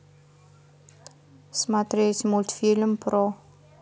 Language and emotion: Russian, neutral